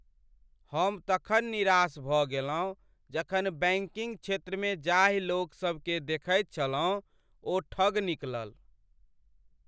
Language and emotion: Maithili, sad